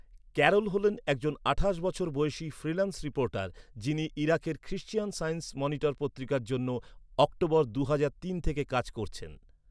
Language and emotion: Bengali, neutral